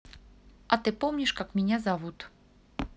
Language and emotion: Russian, neutral